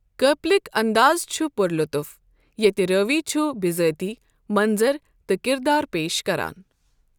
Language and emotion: Kashmiri, neutral